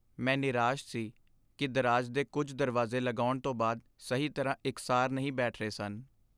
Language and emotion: Punjabi, sad